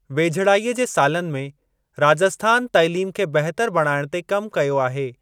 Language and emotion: Sindhi, neutral